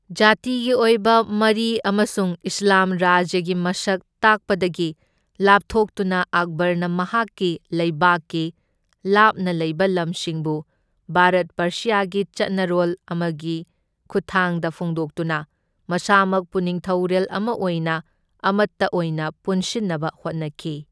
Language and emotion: Manipuri, neutral